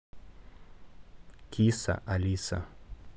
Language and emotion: Russian, neutral